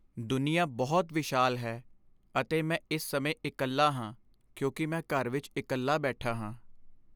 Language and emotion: Punjabi, sad